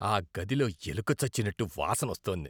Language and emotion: Telugu, disgusted